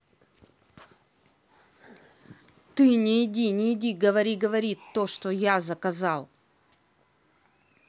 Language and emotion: Russian, angry